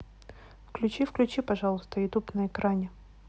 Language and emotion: Russian, neutral